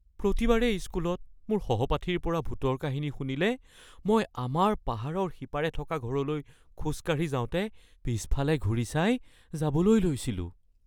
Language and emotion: Assamese, fearful